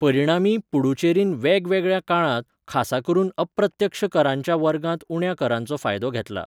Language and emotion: Goan Konkani, neutral